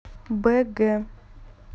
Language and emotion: Russian, neutral